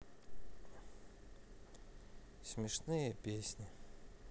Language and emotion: Russian, sad